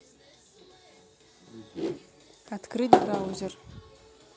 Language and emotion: Russian, neutral